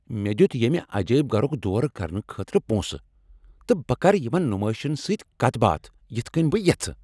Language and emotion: Kashmiri, angry